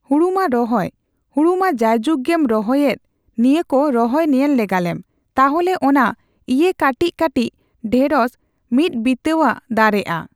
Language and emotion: Santali, neutral